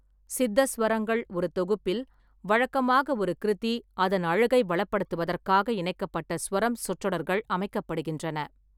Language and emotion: Tamil, neutral